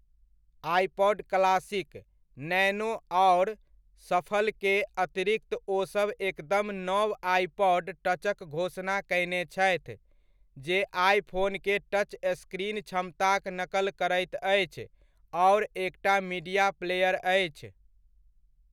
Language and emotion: Maithili, neutral